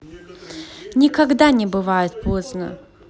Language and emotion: Russian, positive